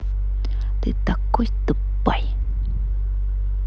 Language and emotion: Russian, angry